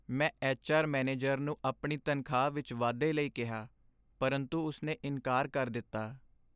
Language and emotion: Punjabi, sad